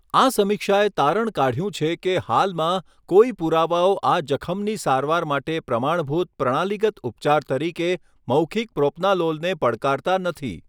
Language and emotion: Gujarati, neutral